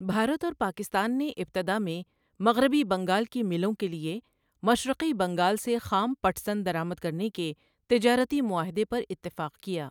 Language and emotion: Urdu, neutral